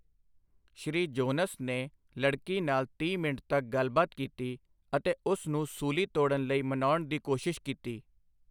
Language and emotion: Punjabi, neutral